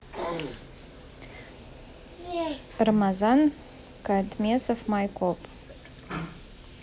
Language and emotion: Russian, neutral